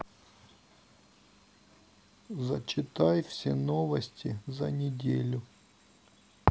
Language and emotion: Russian, sad